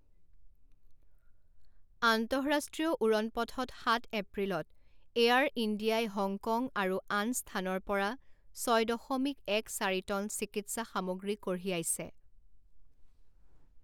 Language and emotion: Assamese, neutral